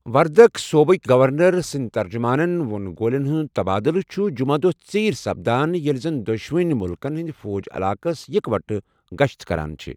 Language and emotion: Kashmiri, neutral